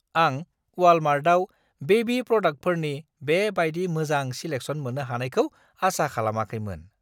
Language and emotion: Bodo, surprised